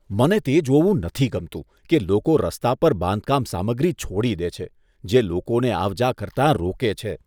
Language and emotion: Gujarati, disgusted